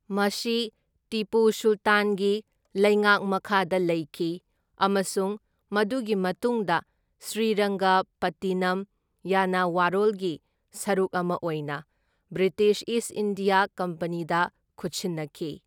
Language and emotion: Manipuri, neutral